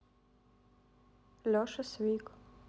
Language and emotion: Russian, neutral